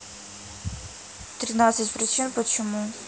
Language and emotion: Russian, neutral